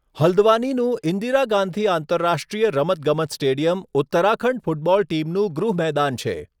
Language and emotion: Gujarati, neutral